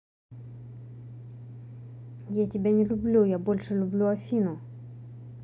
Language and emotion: Russian, neutral